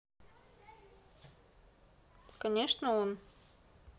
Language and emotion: Russian, neutral